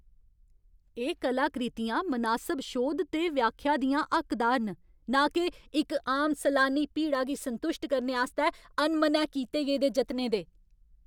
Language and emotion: Dogri, angry